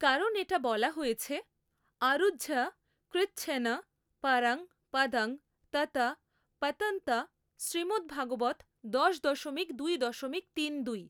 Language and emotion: Bengali, neutral